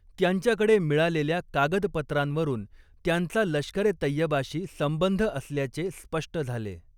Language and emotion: Marathi, neutral